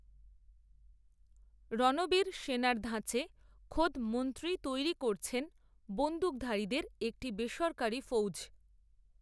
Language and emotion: Bengali, neutral